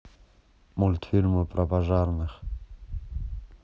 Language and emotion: Russian, neutral